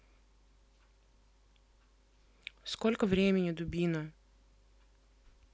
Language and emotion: Russian, neutral